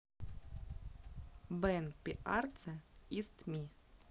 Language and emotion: Russian, neutral